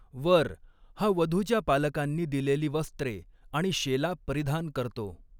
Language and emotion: Marathi, neutral